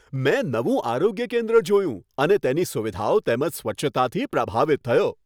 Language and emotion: Gujarati, happy